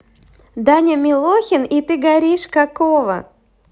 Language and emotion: Russian, positive